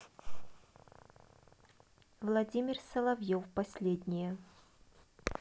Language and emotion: Russian, neutral